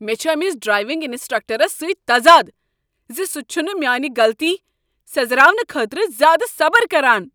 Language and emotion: Kashmiri, angry